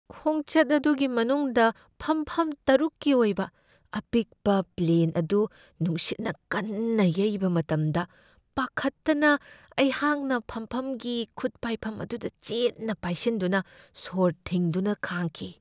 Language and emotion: Manipuri, fearful